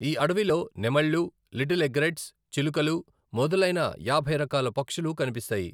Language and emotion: Telugu, neutral